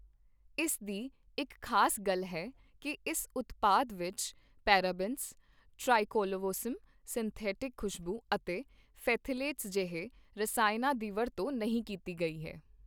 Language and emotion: Punjabi, neutral